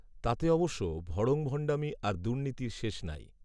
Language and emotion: Bengali, neutral